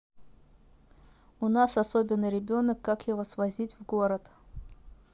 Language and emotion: Russian, neutral